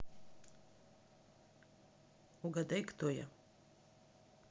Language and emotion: Russian, neutral